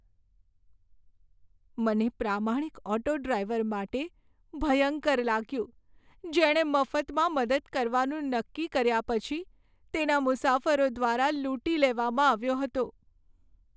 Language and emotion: Gujarati, sad